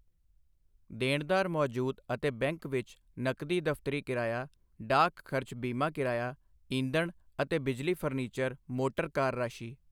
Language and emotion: Punjabi, neutral